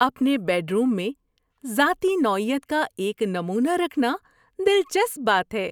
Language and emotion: Urdu, happy